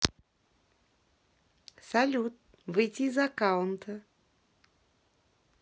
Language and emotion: Russian, positive